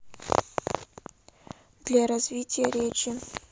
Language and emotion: Russian, neutral